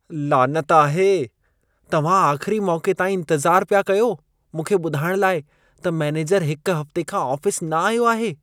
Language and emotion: Sindhi, disgusted